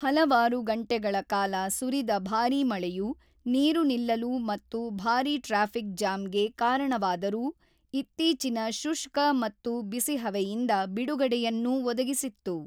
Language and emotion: Kannada, neutral